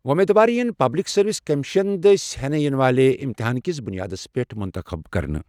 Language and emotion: Kashmiri, neutral